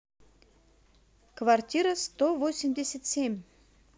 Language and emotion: Russian, positive